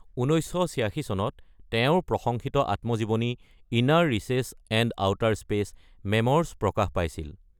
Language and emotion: Assamese, neutral